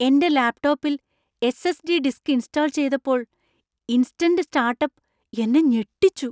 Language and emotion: Malayalam, surprised